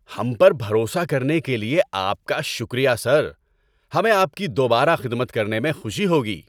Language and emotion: Urdu, happy